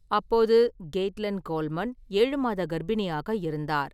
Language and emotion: Tamil, neutral